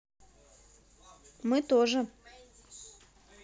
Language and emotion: Russian, neutral